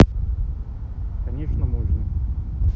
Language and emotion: Russian, neutral